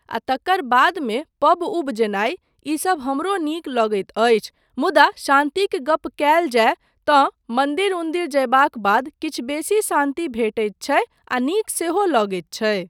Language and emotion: Maithili, neutral